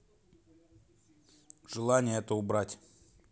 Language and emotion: Russian, neutral